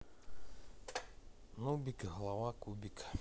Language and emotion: Russian, neutral